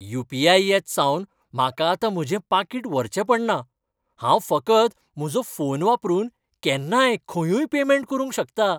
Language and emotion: Goan Konkani, happy